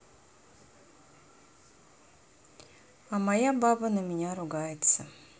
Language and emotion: Russian, sad